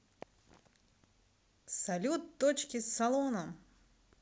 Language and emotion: Russian, positive